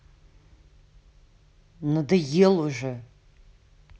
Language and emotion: Russian, angry